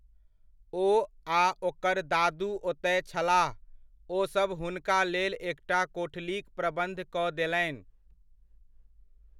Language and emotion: Maithili, neutral